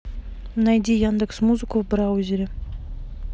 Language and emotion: Russian, neutral